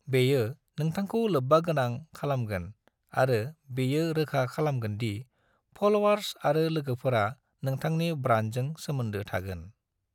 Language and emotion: Bodo, neutral